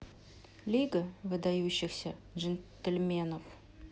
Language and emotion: Russian, neutral